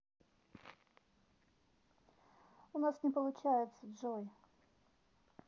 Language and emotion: Russian, neutral